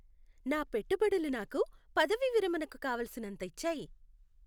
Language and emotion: Telugu, happy